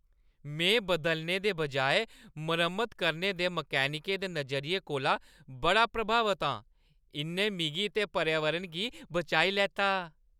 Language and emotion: Dogri, happy